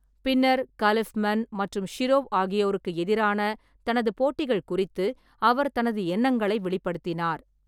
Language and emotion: Tamil, neutral